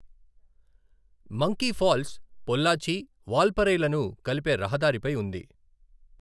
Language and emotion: Telugu, neutral